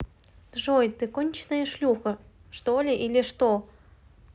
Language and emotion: Russian, neutral